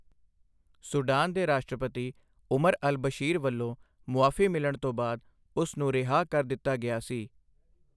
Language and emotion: Punjabi, neutral